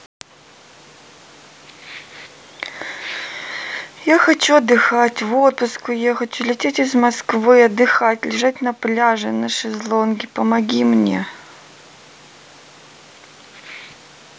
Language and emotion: Russian, sad